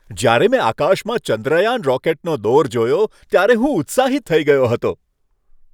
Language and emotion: Gujarati, happy